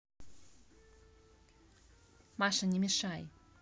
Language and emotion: Russian, neutral